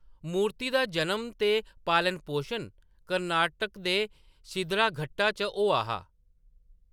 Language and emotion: Dogri, neutral